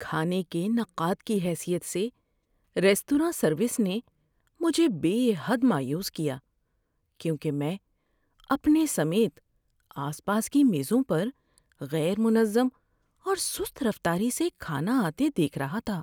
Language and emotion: Urdu, sad